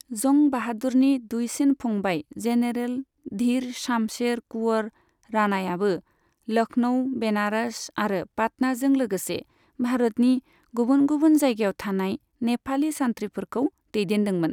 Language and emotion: Bodo, neutral